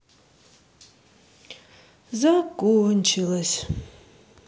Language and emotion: Russian, sad